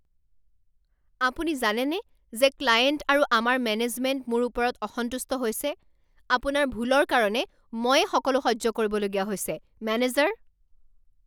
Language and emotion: Assamese, angry